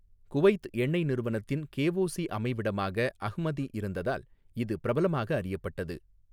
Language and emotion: Tamil, neutral